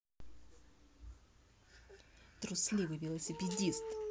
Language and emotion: Russian, angry